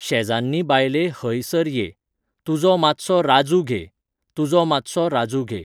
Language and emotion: Goan Konkani, neutral